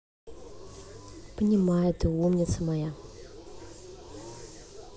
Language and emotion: Russian, positive